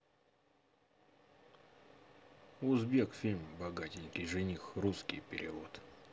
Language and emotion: Russian, neutral